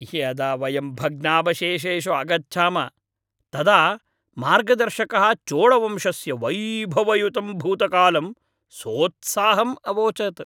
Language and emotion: Sanskrit, happy